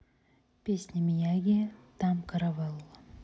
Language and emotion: Russian, neutral